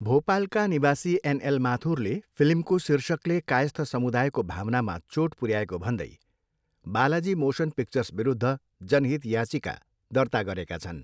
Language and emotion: Nepali, neutral